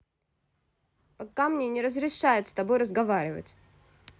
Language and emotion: Russian, angry